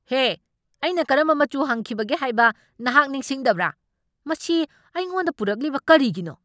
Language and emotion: Manipuri, angry